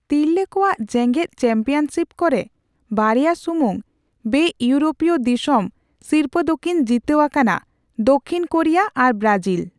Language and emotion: Santali, neutral